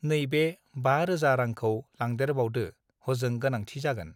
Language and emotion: Bodo, neutral